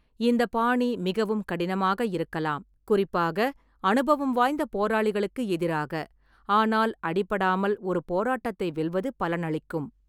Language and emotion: Tamil, neutral